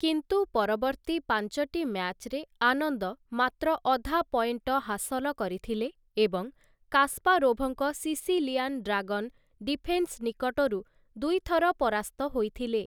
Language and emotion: Odia, neutral